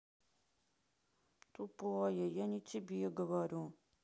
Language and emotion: Russian, sad